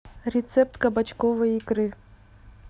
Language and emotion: Russian, neutral